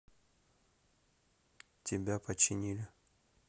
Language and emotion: Russian, neutral